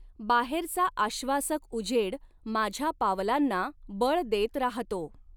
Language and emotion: Marathi, neutral